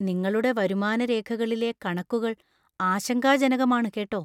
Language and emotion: Malayalam, fearful